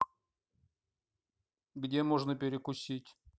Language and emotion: Russian, neutral